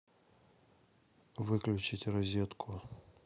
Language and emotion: Russian, neutral